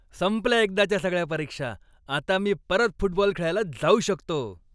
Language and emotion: Marathi, happy